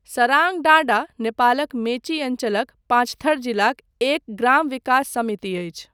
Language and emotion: Maithili, neutral